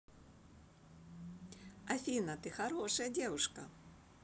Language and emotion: Russian, positive